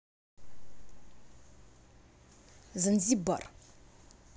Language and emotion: Russian, angry